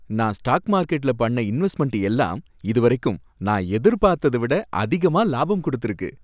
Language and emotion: Tamil, happy